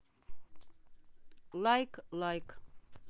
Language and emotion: Russian, neutral